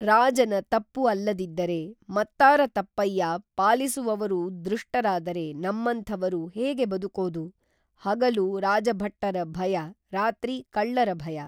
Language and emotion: Kannada, neutral